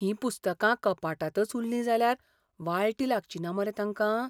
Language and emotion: Goan Konkani, fearful